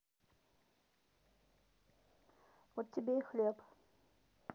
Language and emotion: Russian, neutral